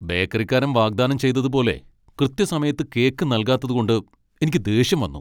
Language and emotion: Malayalam, angry